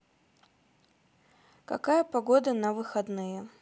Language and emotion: Russian, neutral